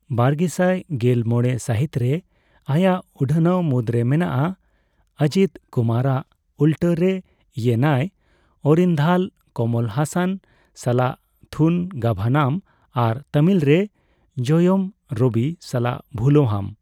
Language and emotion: Santali, neutral